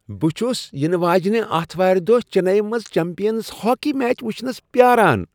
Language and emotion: Kashmiri, happy